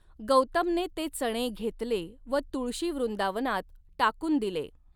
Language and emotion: Marathi, neutral